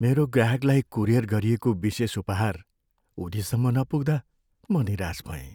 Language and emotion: Nepali, sad